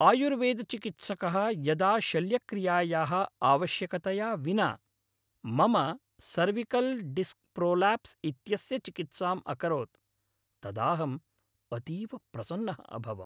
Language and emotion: Sanskrit, happy